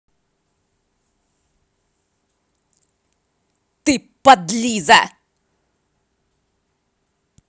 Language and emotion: Russian, angry